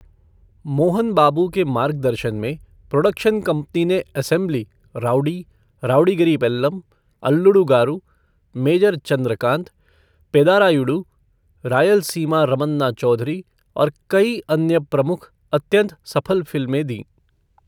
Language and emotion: Hindi, neutral